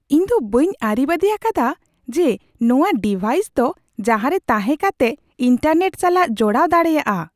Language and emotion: Santali, surprised